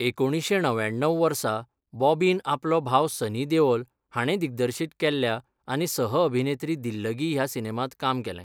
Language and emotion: Goan Konkani, neutral